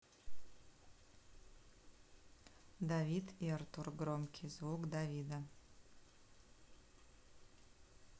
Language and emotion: Russian, neutral